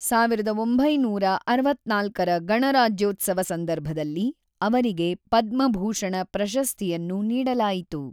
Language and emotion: Kannada, neutral